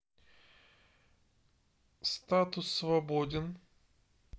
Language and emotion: Russian, neutral